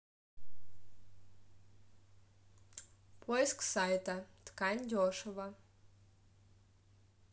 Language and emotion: Russian, neutral